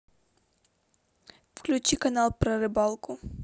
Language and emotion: Russian, neutral